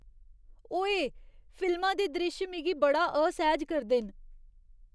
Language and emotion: Dogri, disgusted